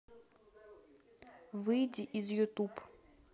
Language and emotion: Russian, neutral